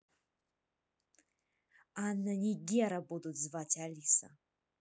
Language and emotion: Russian, angry